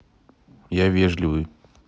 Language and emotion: Russian, neutral